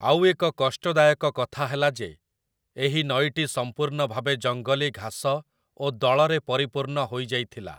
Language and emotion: Odia, neutral